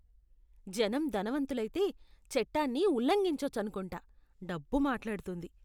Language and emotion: Telugu, disgusted